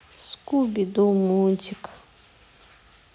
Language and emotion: Russian, sad